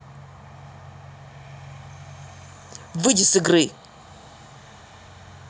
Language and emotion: Russian, angry